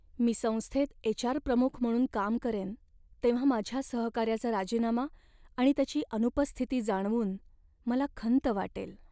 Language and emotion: Marathi, sad